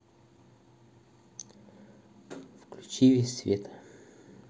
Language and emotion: Russian, neutral